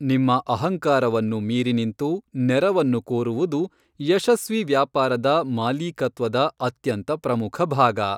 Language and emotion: Kannada, neutral